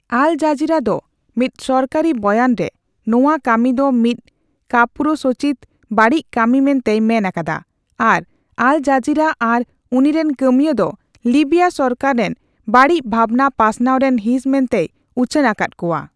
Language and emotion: Santali, neutral